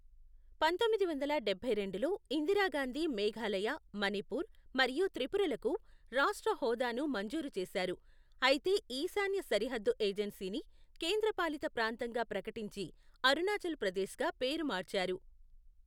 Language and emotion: Telugu, neutral